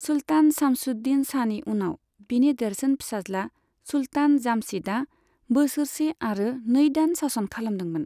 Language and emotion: Bodo, neutral